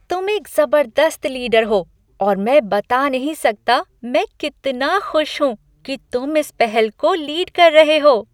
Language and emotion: Hindi, happy